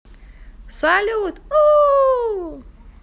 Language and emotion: Russian, positive